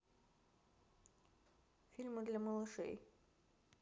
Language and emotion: Russian, neutral